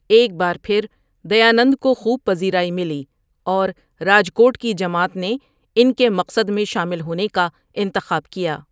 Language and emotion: Urdu, neutral